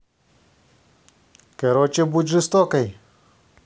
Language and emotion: Russian, positive